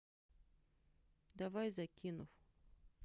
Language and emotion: Russian, neutral